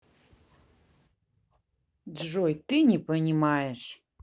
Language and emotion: Russian, angry